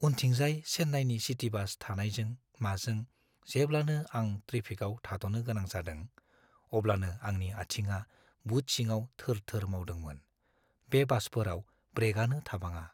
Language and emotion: Bodo, fearful